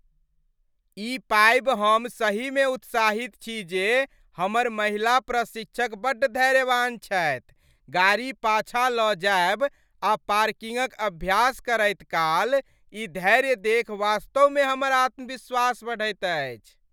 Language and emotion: Maithili, happy